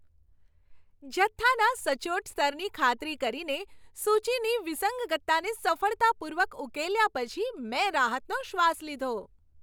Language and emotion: Gujarati, happy